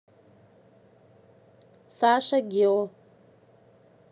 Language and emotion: Russian, neutral